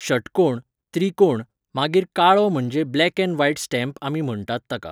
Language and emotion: Goan Konkani, neutral